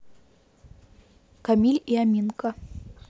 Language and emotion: Russian, neutral